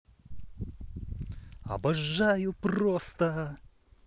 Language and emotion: Russian, positive